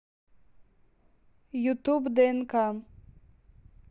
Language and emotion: Russian, neutral